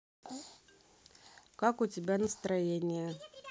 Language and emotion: Russian, neutral